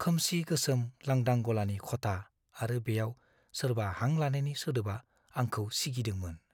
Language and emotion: Bodo, fearful